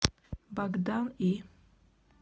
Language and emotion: Russian, neutral